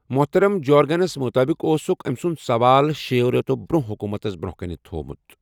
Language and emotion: Kashmiri, neutral